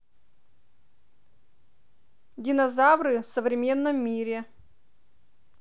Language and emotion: Russian, neutral